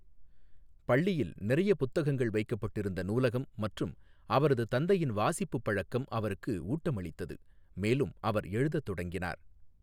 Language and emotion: Tamil, neutral